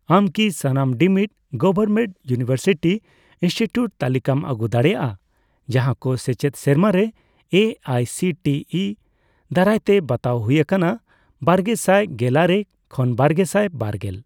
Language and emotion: Santali, neutral